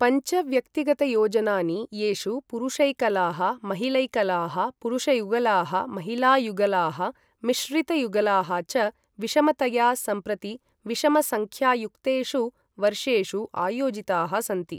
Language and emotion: Sanskrit, neutral